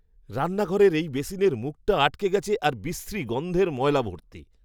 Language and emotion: Bengali, disgusted